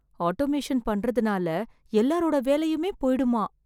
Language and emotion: Tamil, fearful